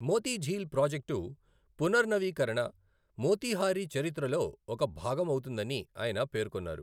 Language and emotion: Telugu, neutral